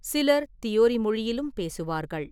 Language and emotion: Tamil, neutral